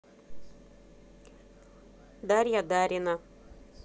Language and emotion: Russian, neutral